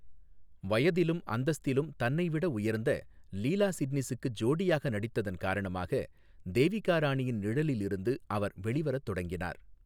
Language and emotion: Tamil, neutral